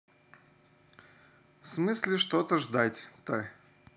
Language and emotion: Russian, neutral